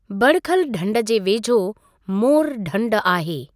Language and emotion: Sindhi, neutral